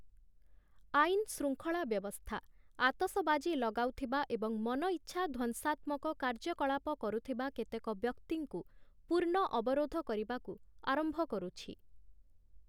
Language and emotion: Odia, neutral